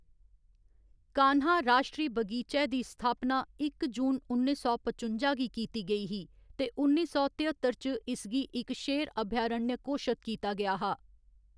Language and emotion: Dogri, neutral